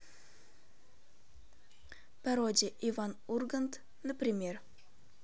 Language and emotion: Russian, neutral